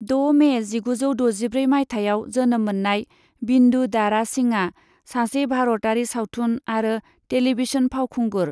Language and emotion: Bodo, neutral